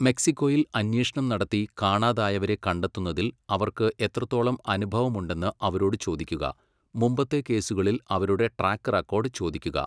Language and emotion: Malayalam, neutral